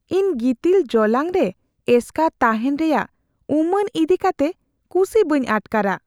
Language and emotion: Santali, fearful